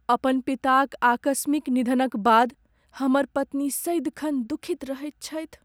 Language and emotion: Maithili, sad